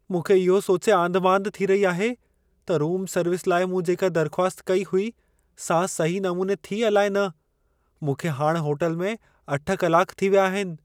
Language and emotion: Sindhi, fearful